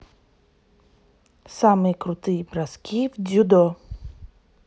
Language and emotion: Russian, neutral